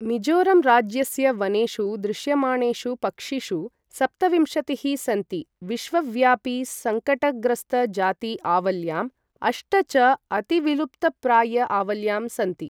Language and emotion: Sanskrit, neutral